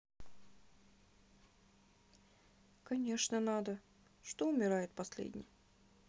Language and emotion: Russian, sad